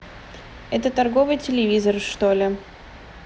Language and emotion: Russian, neutral